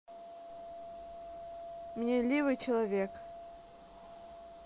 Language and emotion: Russian, neutral